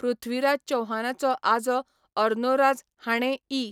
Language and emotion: Goan Konkani, neutral